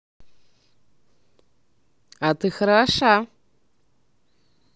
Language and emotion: Russian, positive